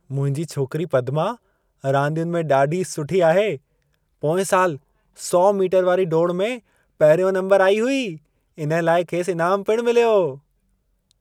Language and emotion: Sindhi, happy